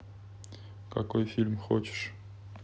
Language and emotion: Russian, neutral